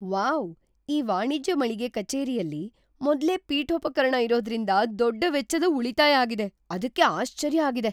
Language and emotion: Kannada, surprised